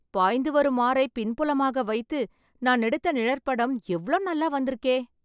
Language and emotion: Tamil, happy